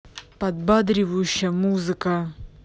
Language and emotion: Russian, angry